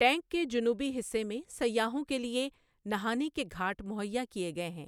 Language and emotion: Urdu, neutral